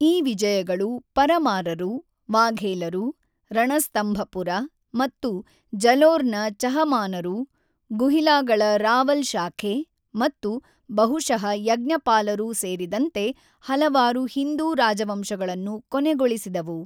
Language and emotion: Kannada, neutral